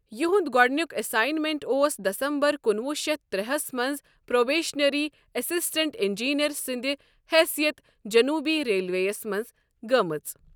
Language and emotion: Kashmiri, neutral